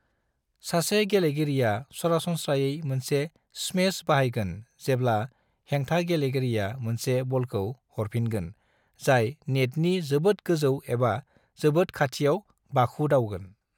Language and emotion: Bodo, neutral